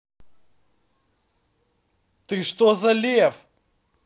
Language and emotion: Russian, angry